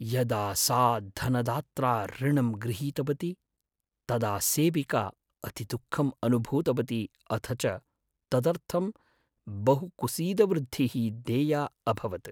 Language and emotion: Sanskrit, sad